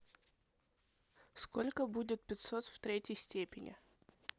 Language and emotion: Russian, neutral